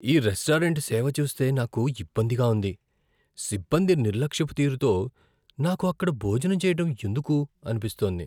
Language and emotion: Telugu, fearful